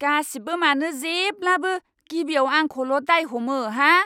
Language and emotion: Bodo, angry